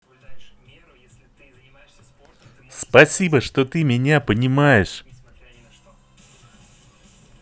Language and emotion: Russian, positive